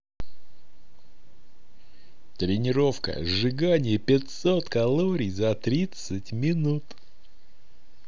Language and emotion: Russian, positive